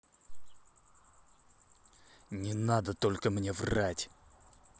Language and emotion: Russian, angry